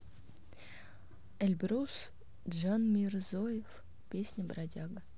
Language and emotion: Russian, neutral